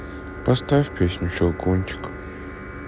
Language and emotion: Russian, sad